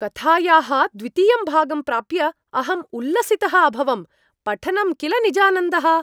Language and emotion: Sanskrit, happy